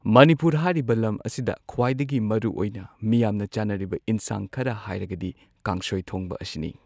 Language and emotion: Manipuri, neutral